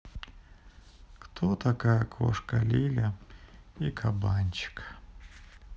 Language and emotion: Russian, sad